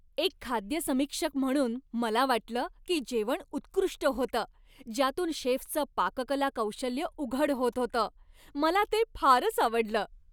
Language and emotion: Marathi, happy